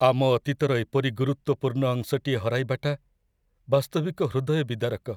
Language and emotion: Odia, sad